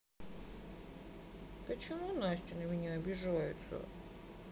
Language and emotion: Russian, sad